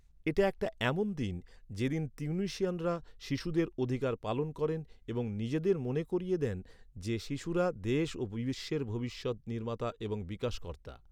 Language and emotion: Bengali, neutral